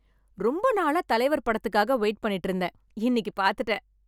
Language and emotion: Tamil, happy